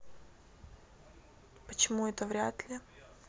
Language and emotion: Russian, neutral